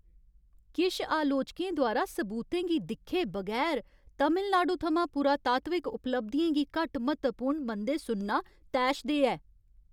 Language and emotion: Dogri, angry